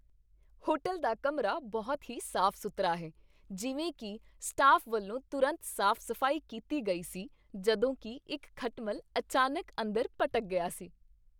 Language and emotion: Punjabi, happy